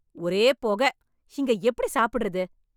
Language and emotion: Tamil, angry